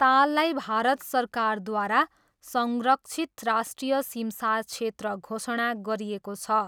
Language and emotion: Nepali, neutral